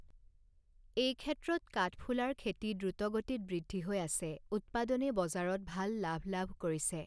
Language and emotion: Assamese, neutral